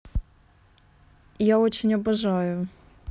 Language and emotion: Russian, neutral